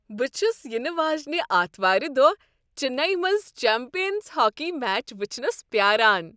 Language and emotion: Kashmiri, happy